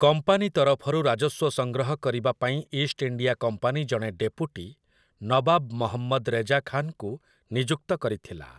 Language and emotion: Odia, neutral